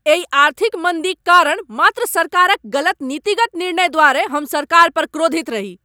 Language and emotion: Maithili, angry